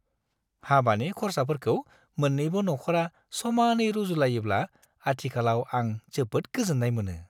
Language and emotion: Bodo, happy